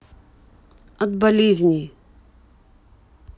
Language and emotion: Russian, neutral